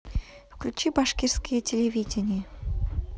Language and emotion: Russian, neutral